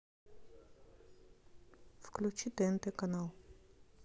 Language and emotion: Russian, neutral